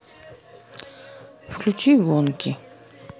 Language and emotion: Russian, neutral